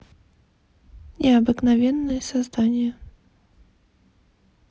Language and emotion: Russian, neutral